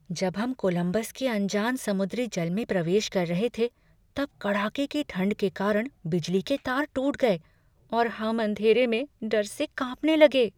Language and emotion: Hindi, fearful